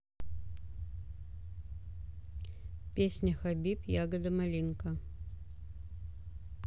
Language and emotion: Russian, neutral